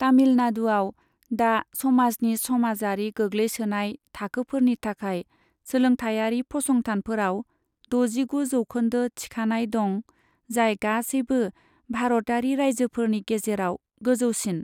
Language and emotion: Bodo, neutral